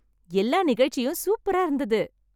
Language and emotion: Tamil, happy